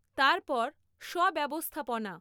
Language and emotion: Bengali, neutral